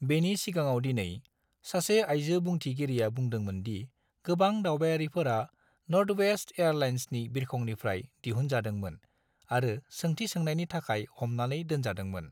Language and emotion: Bodo, neutral